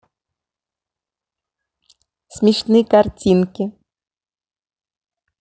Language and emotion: Russian, positive